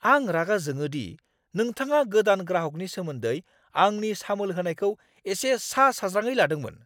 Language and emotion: Bodo, angry